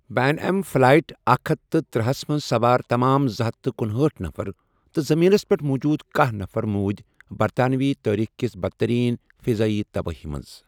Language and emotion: Kashmiri, neutral